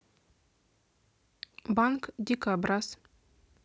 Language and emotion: Russian, neutral